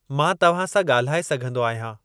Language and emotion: Sindhi, neutral